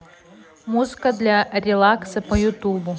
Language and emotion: Russian, neutral